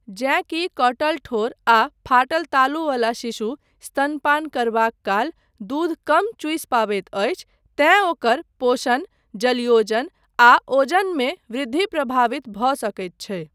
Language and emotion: Maithili, neutral